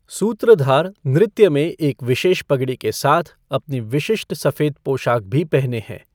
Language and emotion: Hindi, neutral